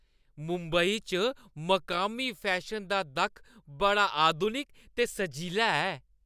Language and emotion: Dogri, happy